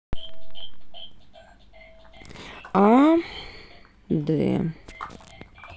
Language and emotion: Russian, neutral